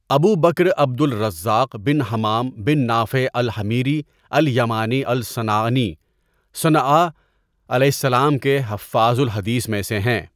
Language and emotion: Urdu, neutral